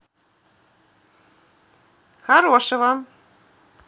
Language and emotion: Russian, positive